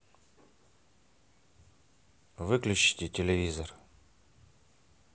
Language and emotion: Russian, neutral